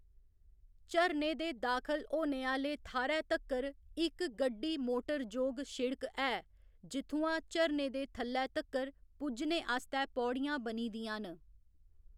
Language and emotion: Dogri, neutral